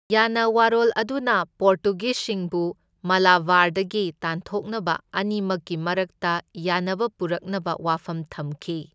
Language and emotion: Manipuri, neutral